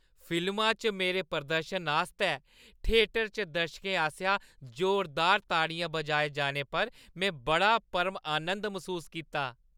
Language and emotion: Dogri, happy